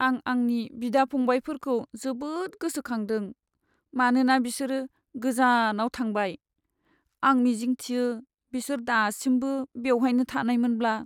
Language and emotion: Bodo, sad